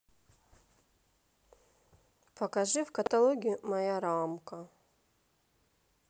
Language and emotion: Russian, neutral